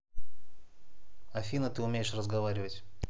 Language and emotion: Russian, neutral